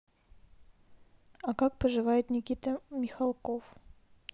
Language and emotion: Russian, neutral